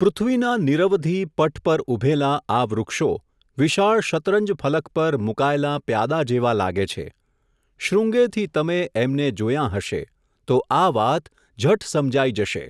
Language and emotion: Gujarati, neutral